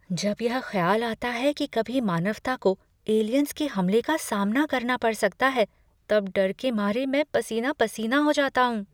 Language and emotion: Hindi, fearful